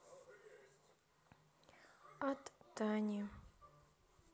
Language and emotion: Russian, sad